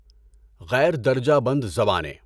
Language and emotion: Urdu, neutral